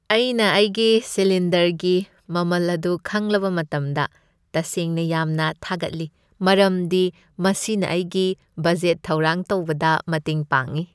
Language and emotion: Manipuri, happy